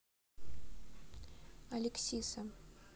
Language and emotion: Russian, neutral